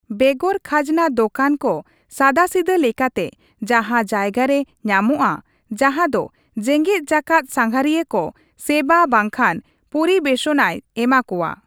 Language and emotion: Santali, neutral